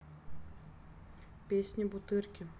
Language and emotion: Russian, neutral